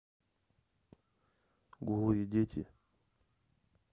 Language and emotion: Russian, neutral